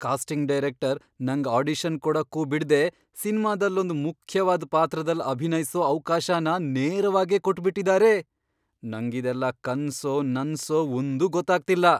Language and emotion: Kannada, surprised